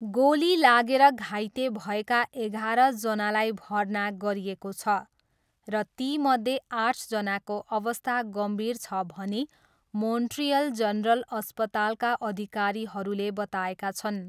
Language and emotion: Nepali, neutral